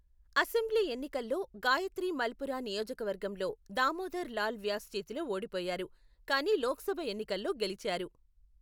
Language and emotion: Telugu, neutral